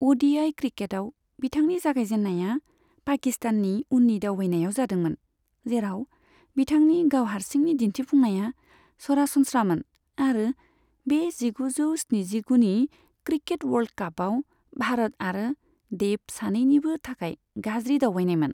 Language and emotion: Bodo, neutral